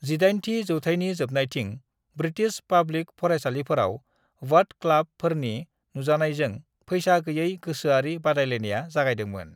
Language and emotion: Bodo, neutral